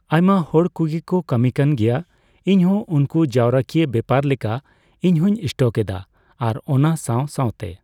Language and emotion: Santali, neutral